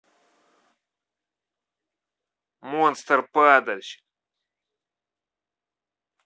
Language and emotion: Russian, angry